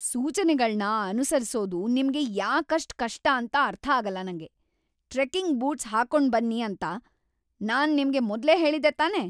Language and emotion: Kannada, angry